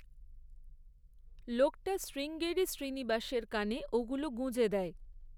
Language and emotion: Bengali, neutral